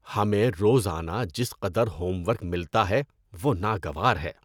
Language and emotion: Urdu, disgusted